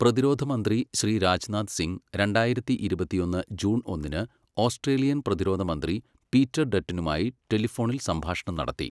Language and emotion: Malayalam, neutral